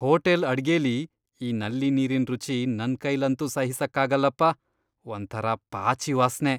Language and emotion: Kannada, disgusted